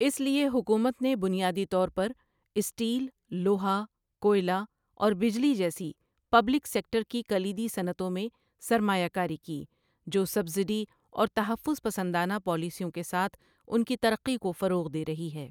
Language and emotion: Urdu, neutral